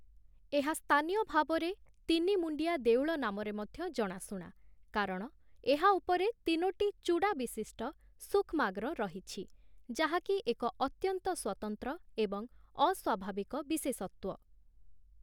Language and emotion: Odia, neutral